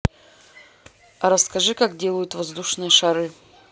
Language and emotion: Russian, neutral